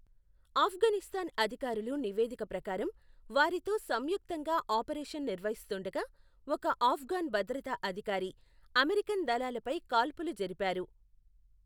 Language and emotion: Telugu, neutral